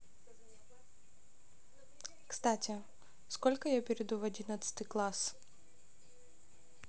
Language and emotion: Russian, neutral